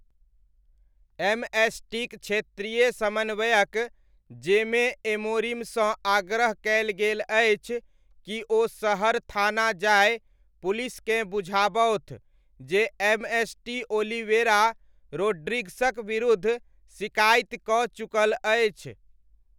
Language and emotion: Maithili, neutral